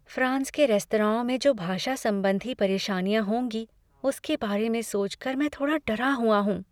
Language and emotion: Hindi, fearful